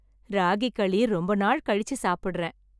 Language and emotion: Tamil, happy